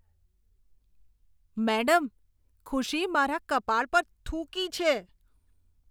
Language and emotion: Gujarati, disgusted